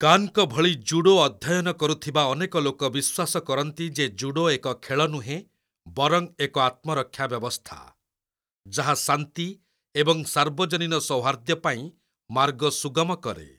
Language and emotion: Odia, neutral